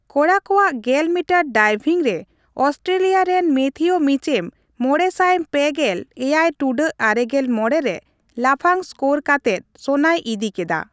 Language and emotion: Santali, neutral